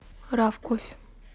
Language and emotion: Russian, neutral